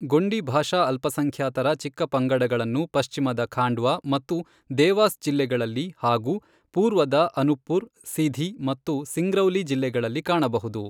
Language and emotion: Kannada, neutral